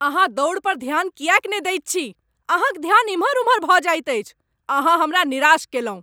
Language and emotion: Maithili, angry